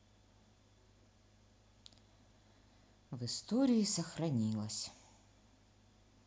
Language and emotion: Russian, sad